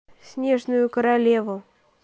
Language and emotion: Russian, neutral